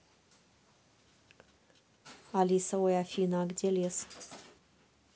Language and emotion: Russian, neutral